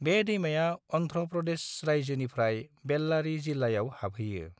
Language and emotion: Bodo, neutral